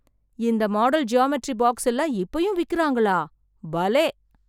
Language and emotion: Tamil, surprised